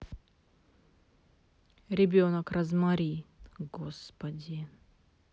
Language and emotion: Russian, neutral